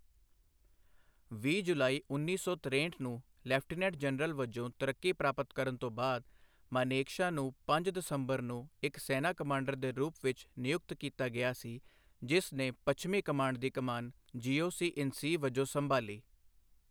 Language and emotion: Punjabi, neutral